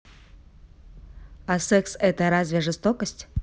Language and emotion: Russian, neutral